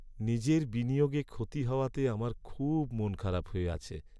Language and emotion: Bengali, sad